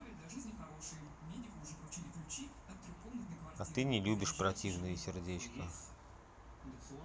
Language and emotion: Russian, neutral